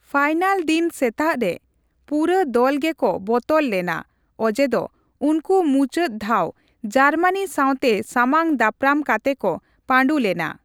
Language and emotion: Santali, neutral